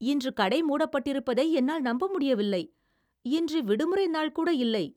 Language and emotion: Tamil, surprised